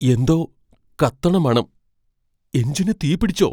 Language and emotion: Malayalam, fearful